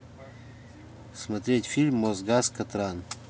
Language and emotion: Russian, neutral